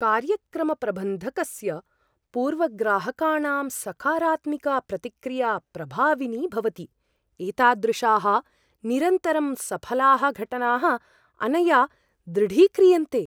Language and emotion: Sanskrit, surprised